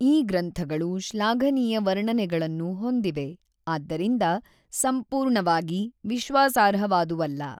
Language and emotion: Kannada, neutral